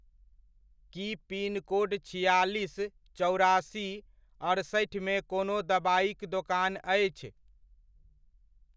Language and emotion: Maithili, neutral